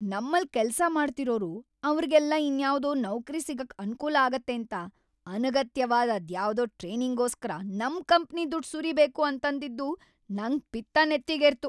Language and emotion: Kannada, angry